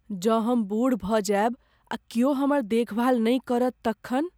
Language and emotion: Maithili, fearful